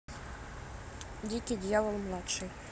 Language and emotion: Russian, neutral